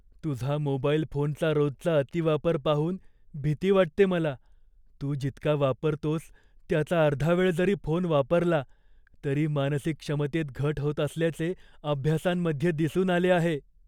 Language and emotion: Marathi, fearful